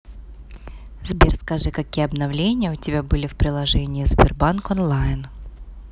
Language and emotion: Russian, neutral